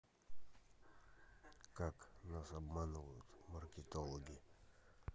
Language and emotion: Russian, neutral